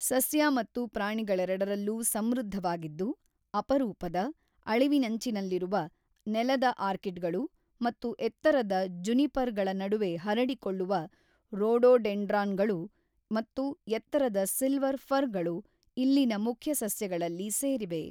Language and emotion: Kannada, neutral